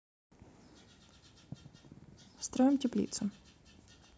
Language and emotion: Russian, neutral